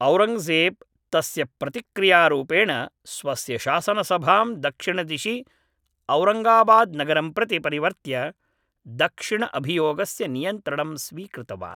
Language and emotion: Sanskrit, neutral